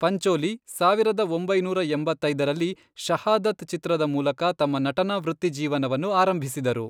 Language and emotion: Kannada, neutral